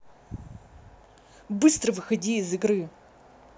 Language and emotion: Russian, angry